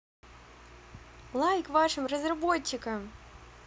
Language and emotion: Russian, positive